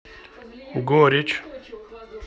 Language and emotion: Russian, neutral